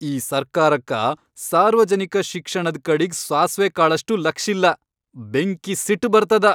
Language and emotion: Kannada, angry